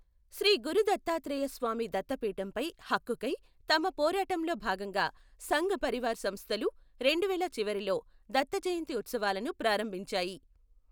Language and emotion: Telugu, neutral